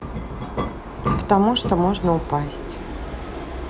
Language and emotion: Russian, neutral